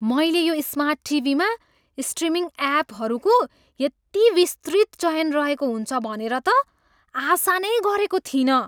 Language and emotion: Nepali, surprised